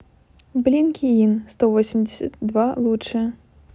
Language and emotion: Russian, neutral